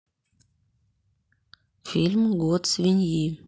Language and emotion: Russian, neutral